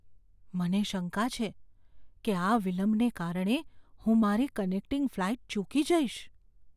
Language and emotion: Gujarati, fearful